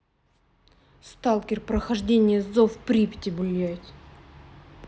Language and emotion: Russian, angry